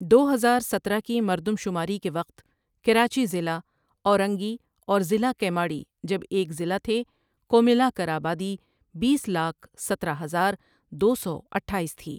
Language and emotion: Urdu, neutral